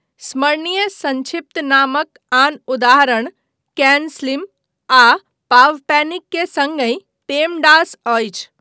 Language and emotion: Maithili, neutral